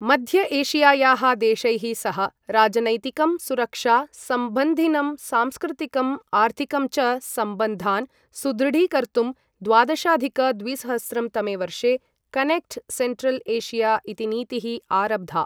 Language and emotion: Sanskrit, neutral